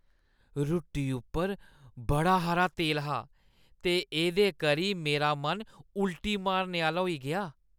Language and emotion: Dogri, disgusted